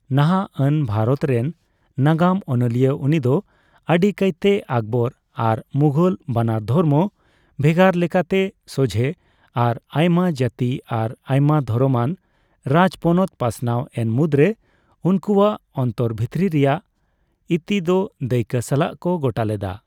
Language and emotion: Santali, neutral